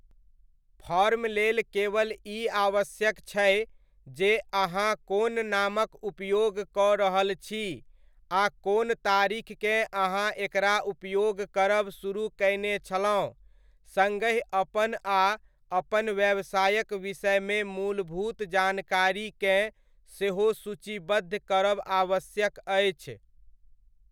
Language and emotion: Maithili, neutral